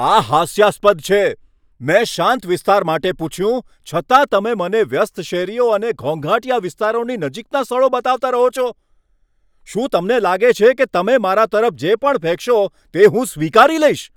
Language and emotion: Gujarati, angry